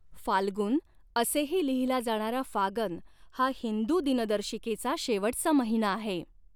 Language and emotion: Marathi, neutral